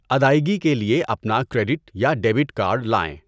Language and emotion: Urdu, neutral